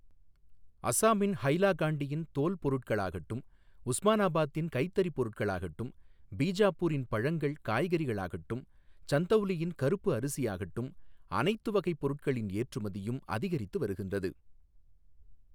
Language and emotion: Tamil, neutral